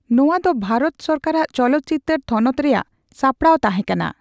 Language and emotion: Santali, neutral